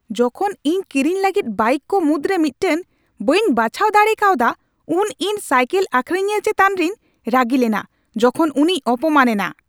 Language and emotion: Santali, angry